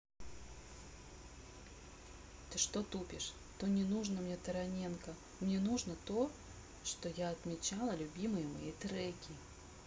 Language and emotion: Russian, neutral